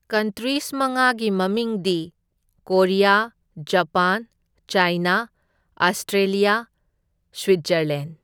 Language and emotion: Manipuri, neutral